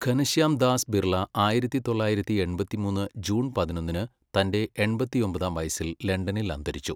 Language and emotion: Malayalam, neutral